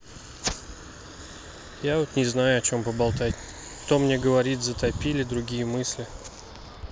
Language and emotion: Russian, sad